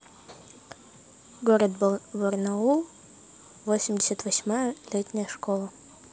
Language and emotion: Russian, neutral